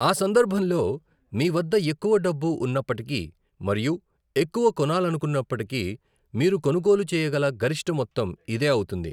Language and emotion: Telugu, neutral